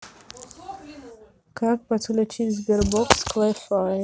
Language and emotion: Russian, neutral